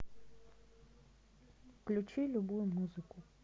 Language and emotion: Russian, neutral